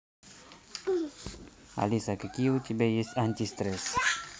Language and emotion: Russian, neutral